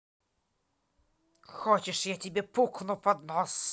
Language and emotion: Russian, angry